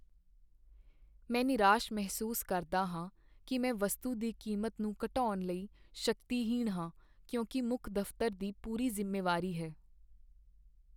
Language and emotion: Punjabi, sad